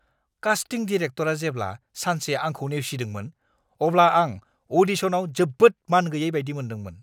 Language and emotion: Bodo, angry